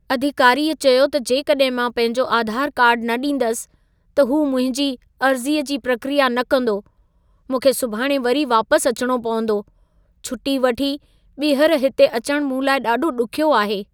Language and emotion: Sindhi, sad